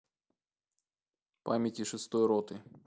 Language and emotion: Russian, neutral